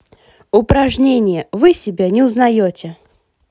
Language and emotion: Russian, positive